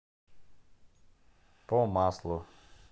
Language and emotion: Russian, neutral